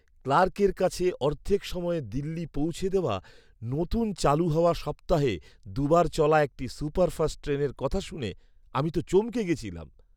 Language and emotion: Bengali, surprised